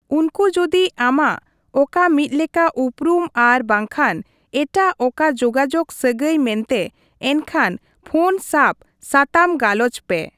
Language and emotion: Santali, neutral